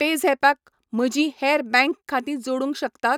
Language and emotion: Goan Konkani, neutral